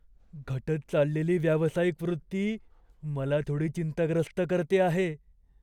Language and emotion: Marathi, fearful